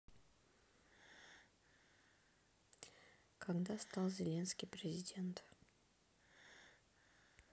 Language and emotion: Russian, neutral